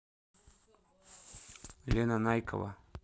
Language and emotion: Russian, neutral